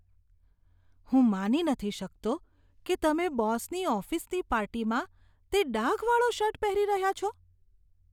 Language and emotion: Gujarati, disgusted